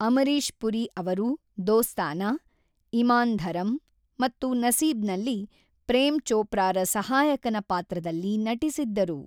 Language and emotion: Kannada, neutral